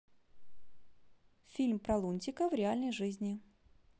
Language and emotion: Russian, neutral